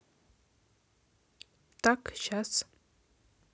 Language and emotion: Russian, neutral